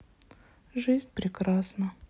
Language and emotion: Russian, sad